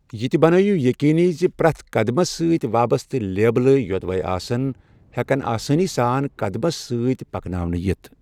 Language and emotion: Kashmiri, neutral